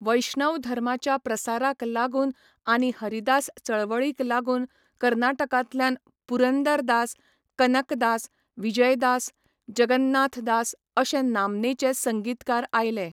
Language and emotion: Goan Konkani, neutral